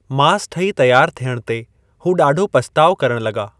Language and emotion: Sindhi, neutral